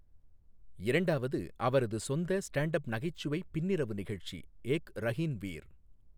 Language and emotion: Tamil, neutral